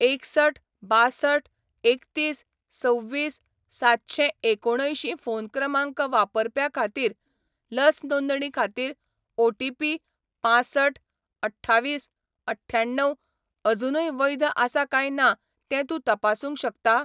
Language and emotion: Goan Konkani, neutral